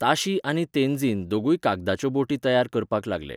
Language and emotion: Goan Konkani, neutral